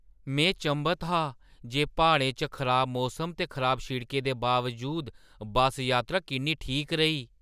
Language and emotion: Dogri, surprised